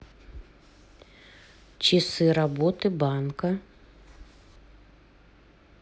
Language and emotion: Russian, neutral